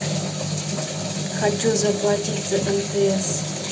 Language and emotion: Russian, neutral